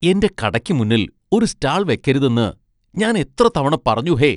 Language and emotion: Malayalam, disgusted